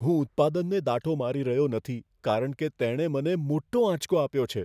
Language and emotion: Gujarati, fearful